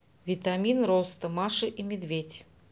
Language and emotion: Russian, neutral